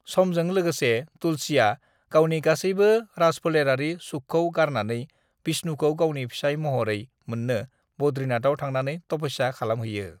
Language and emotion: Bodo, neutral